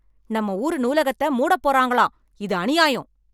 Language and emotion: Tamil, angry